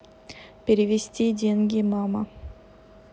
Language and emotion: Russian, neutral